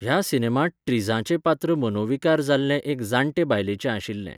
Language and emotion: Goan Konkani, neutral